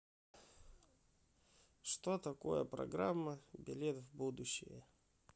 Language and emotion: Russian, neutral